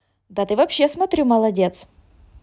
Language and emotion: Russian, positive